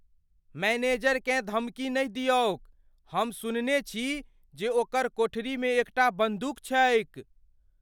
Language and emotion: Maithili, fearful